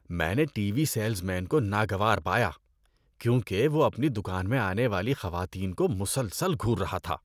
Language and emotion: Urdu, disgusted